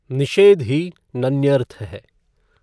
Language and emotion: Hindi, neutral